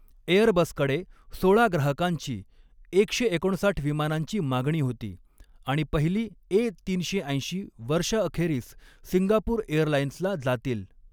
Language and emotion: Marathi, neutral